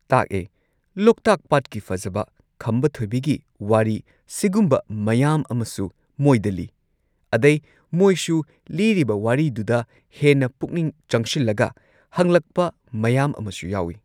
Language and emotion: Manipuri, neutral